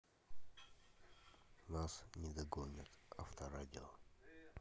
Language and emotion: Russian, neutral